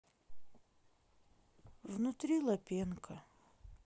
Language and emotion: Russian, sad